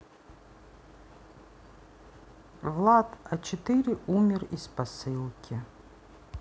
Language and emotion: Russian, neutral